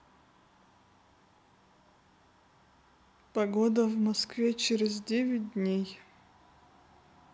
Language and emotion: Russian, neutral